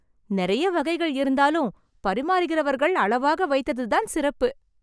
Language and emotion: Tamil, happy